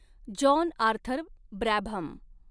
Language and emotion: Marathi, neutral